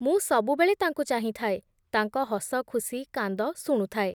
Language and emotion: Odia, neutral